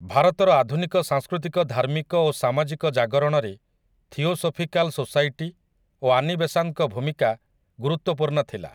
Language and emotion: Odia, neutral